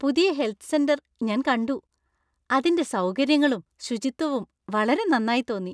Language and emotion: Malayalam, happy